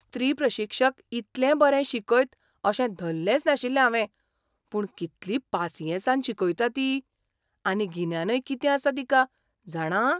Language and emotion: Goan Konkani, surprised